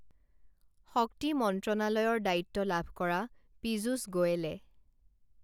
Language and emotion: Assamese, neutral